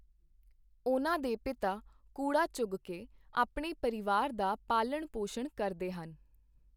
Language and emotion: Punjabi, neutral